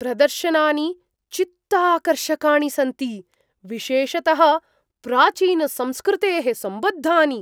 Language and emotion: Sanskrit, surprised